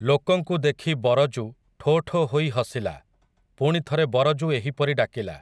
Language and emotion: Odia, neutral